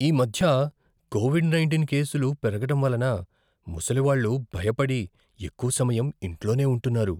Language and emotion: Telugu, fearful